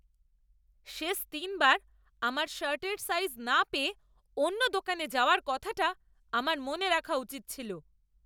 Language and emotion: Bengali, angry